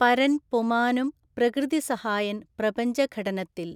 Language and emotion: Malayalam, neutral